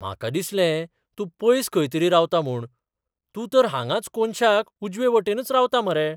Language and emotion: Goan Konkani, surprised